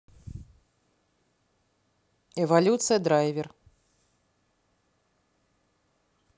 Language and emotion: Russian, neutral